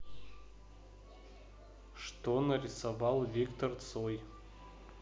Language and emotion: Russian, neutral